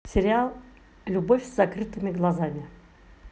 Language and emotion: Russian, positive